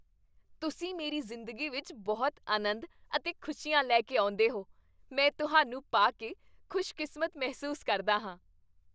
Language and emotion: Punjabi, happy